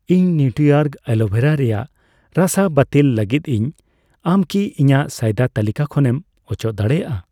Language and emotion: Santali, neutral